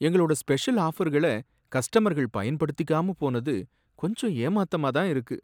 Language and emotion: Tamil, sad